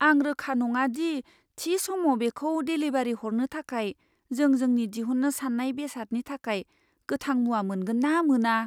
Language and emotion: Bodo, fearful